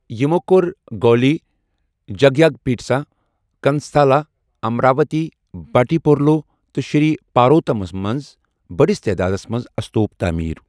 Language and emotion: Kashmiri, neutral